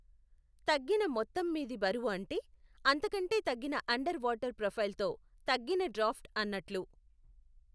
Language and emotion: Telugu, neutral